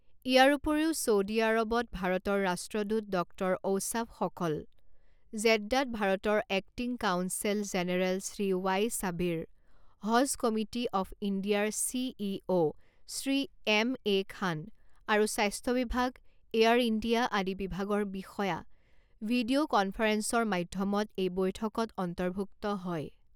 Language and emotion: Assamese, neutral